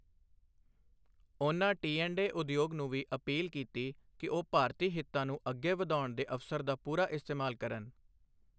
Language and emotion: Punjabi, neutral